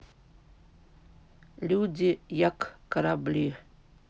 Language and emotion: Russian, neutral